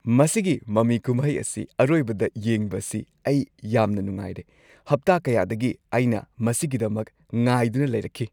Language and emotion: Manipuri, happy